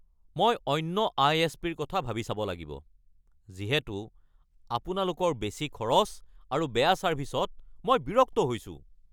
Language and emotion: Assamese, angry